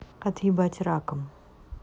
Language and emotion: Russian, neutral